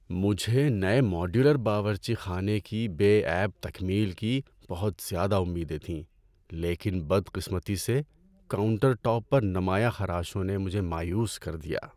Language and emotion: Urdu, sad